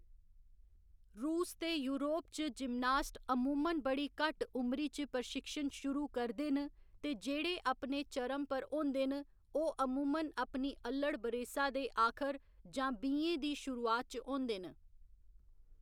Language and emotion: Dogri, neutral